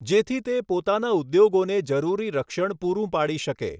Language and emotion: Gujarati, neutral